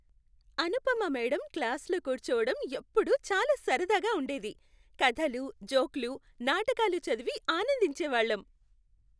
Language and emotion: Telugu, happy